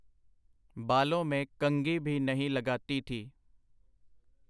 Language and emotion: Punjabi, neutral